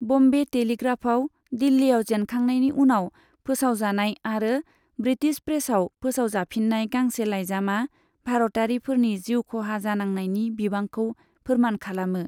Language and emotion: Bodo, neutral